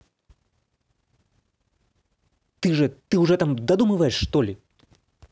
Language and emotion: Russian, angry